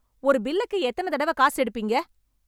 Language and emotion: Tamil, angry